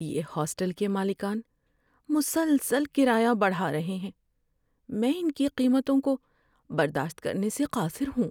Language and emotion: Urdu, sad